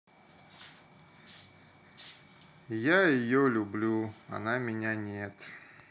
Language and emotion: Russian, sad